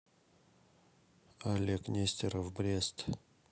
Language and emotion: Russian, neutral